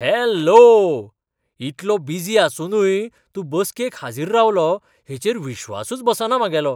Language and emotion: Goan Konkani, surprised